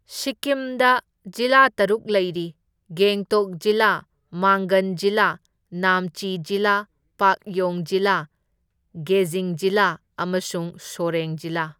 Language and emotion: Manipuri, neutral